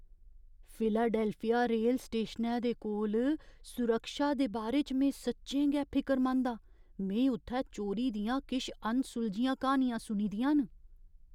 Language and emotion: Dogri, fearful